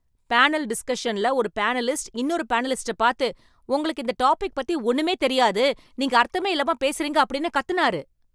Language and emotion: Tamil, angry